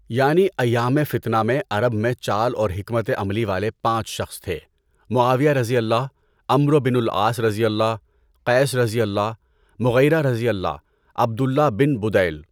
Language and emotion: Urdu, neutral